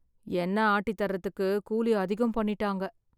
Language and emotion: Tamil, sad